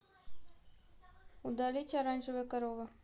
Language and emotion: Russian, neutral